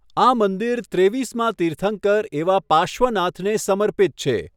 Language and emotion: Gujarati, neutral